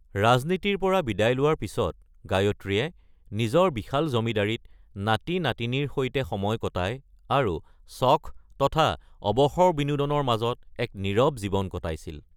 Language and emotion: Assamese, neutral